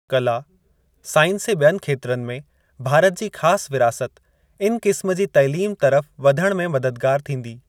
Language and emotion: Sindhi, neutral